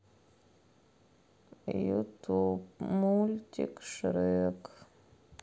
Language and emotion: Russian, sad